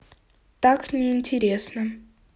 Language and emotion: Russian, neutral